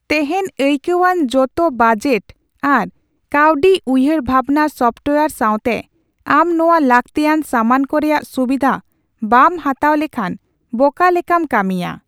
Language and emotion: Santali, neutral